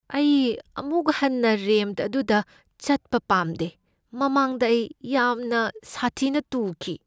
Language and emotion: Manipuri, fearful